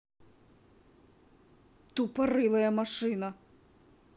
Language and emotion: Russian, angry